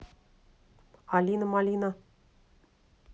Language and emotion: Russian, neutral